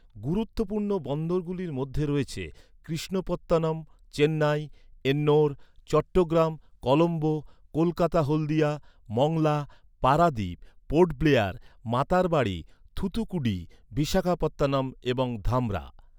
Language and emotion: Bengali, neutral